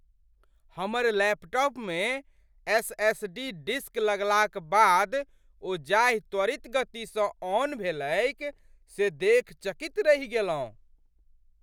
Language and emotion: Maithili, surprised